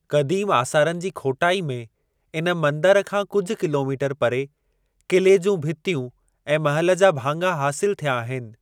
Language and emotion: Sindhi, neutral